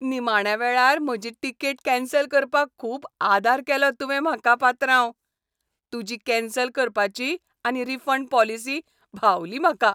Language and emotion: Goan Konkani, happy